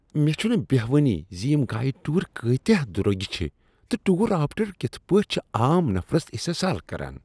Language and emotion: Kashmiri, disgusted